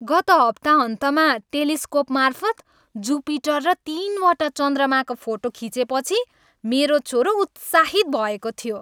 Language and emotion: Nepali, happy